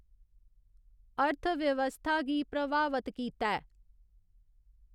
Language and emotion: Dogri, neutral